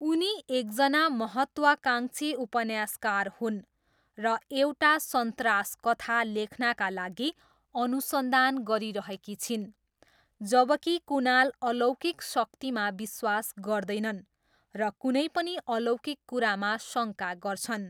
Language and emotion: Nepali, neutral